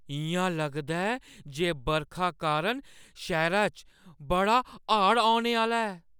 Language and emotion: Dogri, fearful